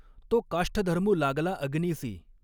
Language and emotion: Marathi, neutral